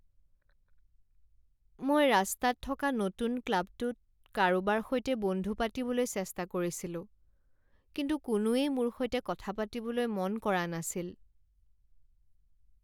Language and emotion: Assamese, sad